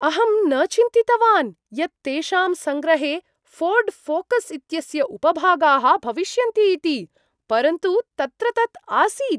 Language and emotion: Sanskrit, surprised